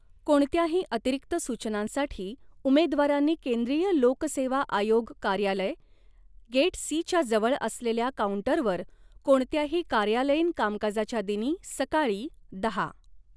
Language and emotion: Marathi, neutral